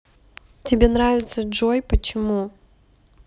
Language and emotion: Russian, neutral